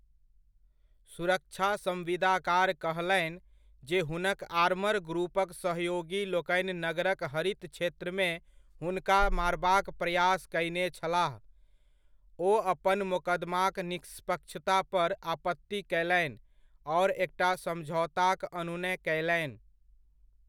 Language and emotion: Maithili, neutral